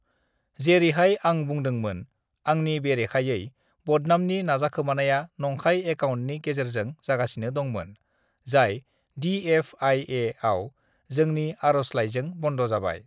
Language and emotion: Bodo, neutral